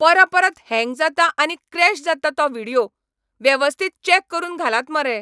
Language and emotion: Goan Konkani, angry